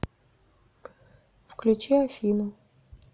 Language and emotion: Russian, neutral